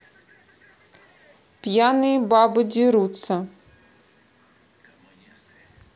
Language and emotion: Russian, neutral